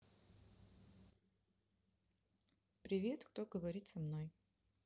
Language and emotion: Russian, neutral